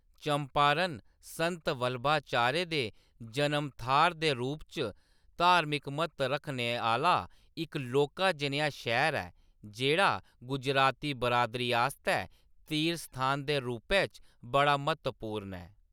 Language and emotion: Dogri, neutral